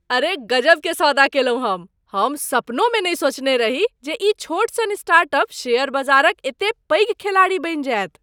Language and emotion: Maithili, surprised